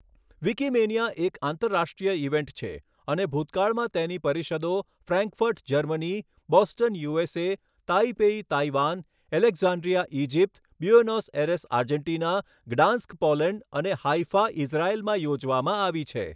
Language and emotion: Gujarati, neutral